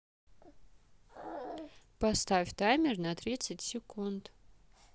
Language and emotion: Russian, neutral